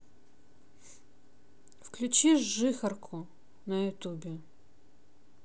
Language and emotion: Russian, neutral